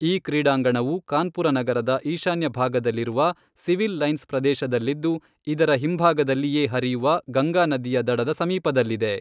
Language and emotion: Kannada, neutral